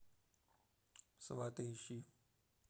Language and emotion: Russian, neutral